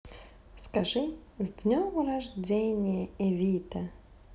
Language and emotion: Russian, positive